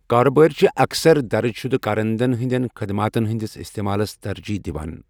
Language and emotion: Kashmiri, neutral